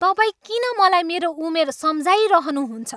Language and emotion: Nepali, angry